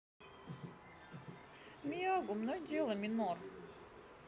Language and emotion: Russian, neutral